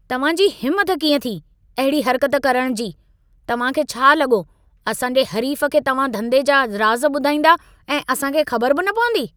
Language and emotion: Sindhi, angry